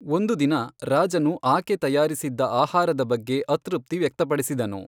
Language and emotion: Kannada, neutral